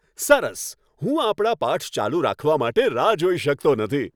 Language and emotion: Gujarati, happy